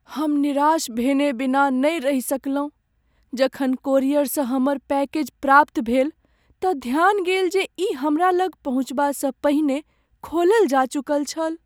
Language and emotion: Maithili, sad